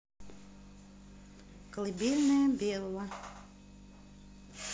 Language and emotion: Russian, neutral